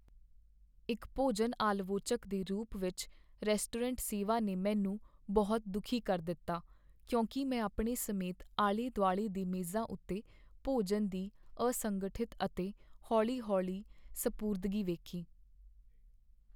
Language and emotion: Punjabi, sad